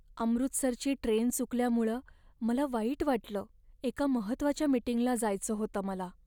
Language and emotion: Marathi, sad